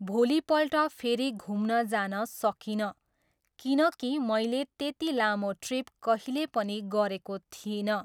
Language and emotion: Nepali, neutral